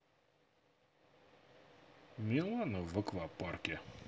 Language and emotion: Russian, neutral